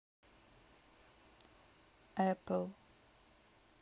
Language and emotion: Russian, neutral